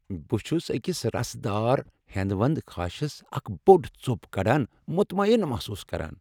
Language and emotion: Kashmiri, happy